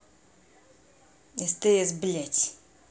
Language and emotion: Russian, angry